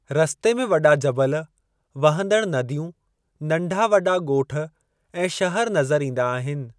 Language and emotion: Sindhi, neutral